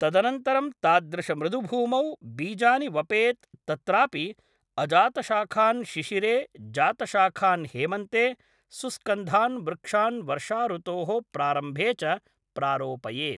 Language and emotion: Sanskrit, neutral